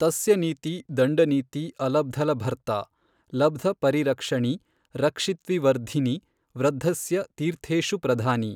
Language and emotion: Kannada, neutral